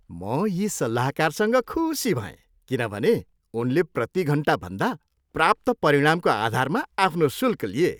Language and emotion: Nepali, happy